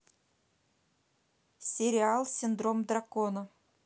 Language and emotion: Russian, neutral